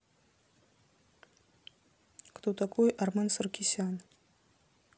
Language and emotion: Russian, neutral